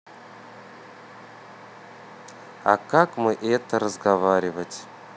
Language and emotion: Russian, neutral